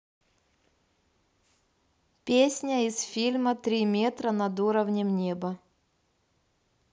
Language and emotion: Russian, neutral